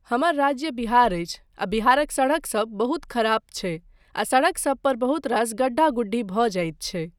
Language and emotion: Maithili, neutral